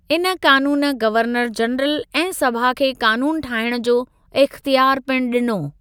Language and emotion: Sindhi, neutral